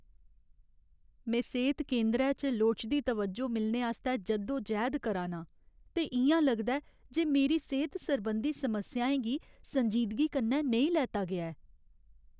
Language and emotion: Dogri, sad